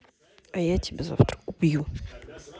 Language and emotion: Russian, neutral